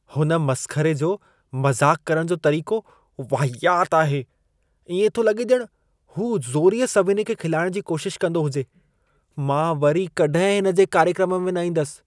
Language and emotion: Sindhi, disgusted